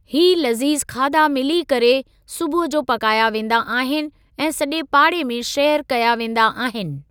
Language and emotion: Sindhi, neutral